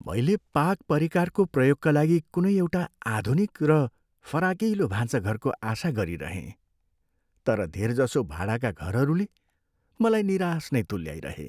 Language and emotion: Nepali, sad